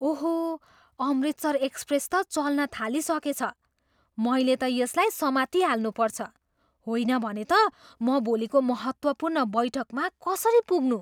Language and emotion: Nepali, surprised